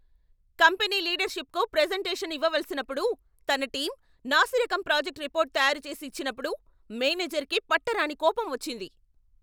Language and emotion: Telugu, angry